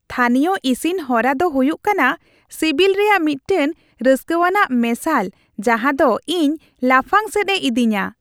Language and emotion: Santali, happy